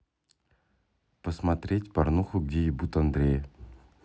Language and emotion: Russian, neutral